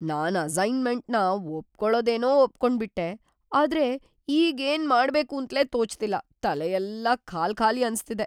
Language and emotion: Kannada, fearful